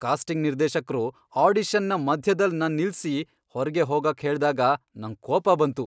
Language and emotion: Kannada, angry